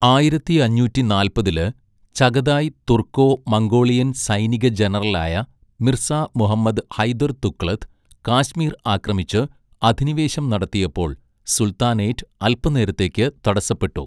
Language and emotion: Malayalam, neutral